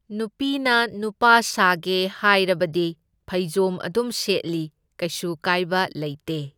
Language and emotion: Manipuri, neutral